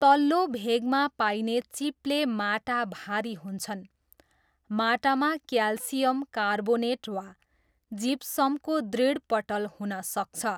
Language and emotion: Nepali, neutral